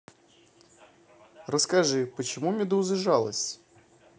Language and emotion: Russian, neutral